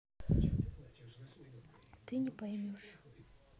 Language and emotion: Russian, sad